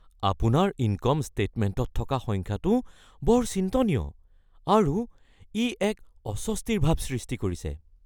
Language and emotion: Assamese, fearful